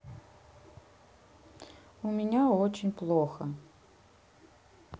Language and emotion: Russian, sad